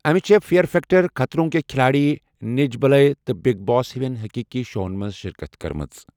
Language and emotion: Kashmiri, neutral